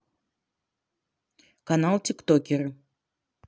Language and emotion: Russian, neutral